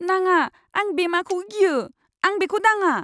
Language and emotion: Bodo, fearful